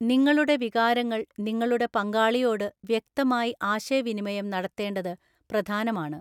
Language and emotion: Malayalam, neutral